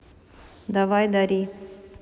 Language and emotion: Russian, neutral